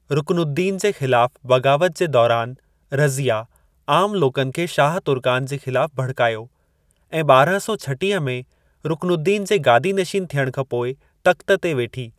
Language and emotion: Sindhi, neutral